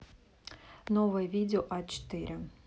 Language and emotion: Russian, neutral